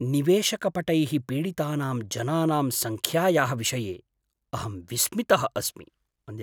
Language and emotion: Sanskrit, surprised